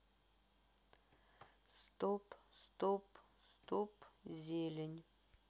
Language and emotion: Russian, neutral